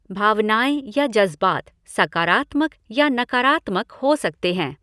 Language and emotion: Hindi, neutral